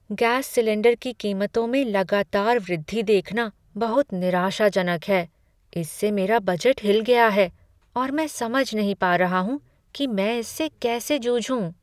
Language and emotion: Hindi, sad